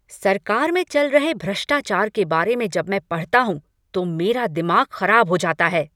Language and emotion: Hindi, angry